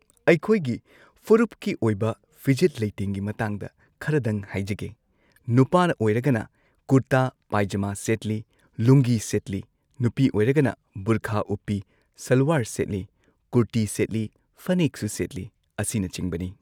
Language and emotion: Manipuri, neutral